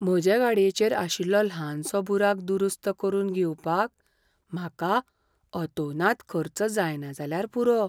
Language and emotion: Goan Konkani, fearful